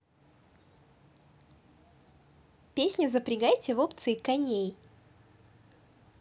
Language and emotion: Russian, positive